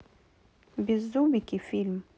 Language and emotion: Russian, neutral